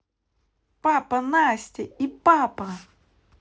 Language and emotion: Russian, neutral